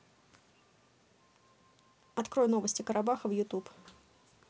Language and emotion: Russian, neutral